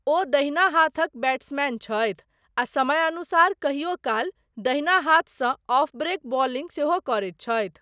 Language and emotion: Maithili, neutral